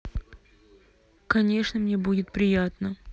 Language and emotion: Russian, neutral